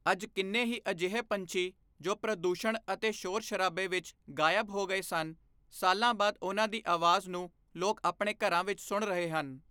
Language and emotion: Punjabi, neutral